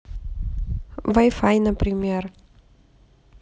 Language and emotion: Russian, neutral